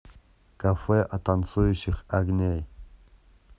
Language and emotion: Russian, neutral